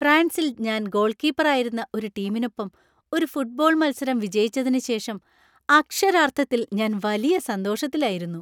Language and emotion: Malayalam, happy